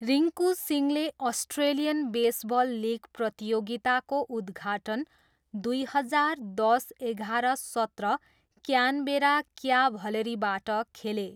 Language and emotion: Nepali, neutral